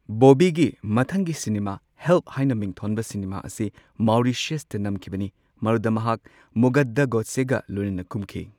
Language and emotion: Manipuri, neutral